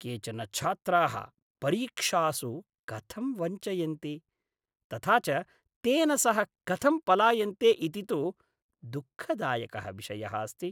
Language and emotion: Sanskrit, disgusted